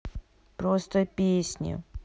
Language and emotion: Russian, neutral